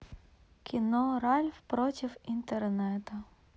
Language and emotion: Russian, sad